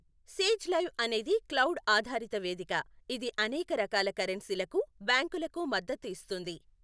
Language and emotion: Telugu, neutral